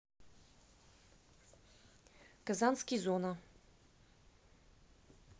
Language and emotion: Russian, neutral